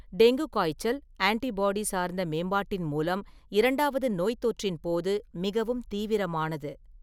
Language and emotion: Tamil, neutral